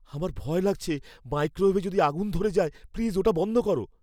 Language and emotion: Bengali, fearful